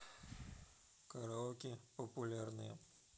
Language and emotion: Russian, neutral